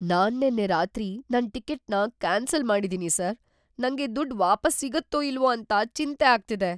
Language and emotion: Kannada, fearful